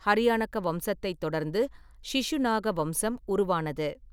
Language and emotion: Tamil, neutral